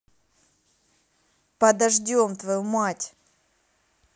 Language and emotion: Russian, angry